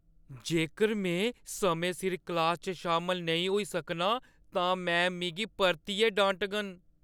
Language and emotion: Dogri, fearful